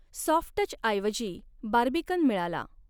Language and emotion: Marathi, neutral